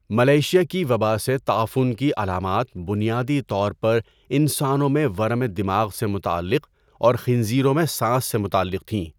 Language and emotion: Urdu, neutral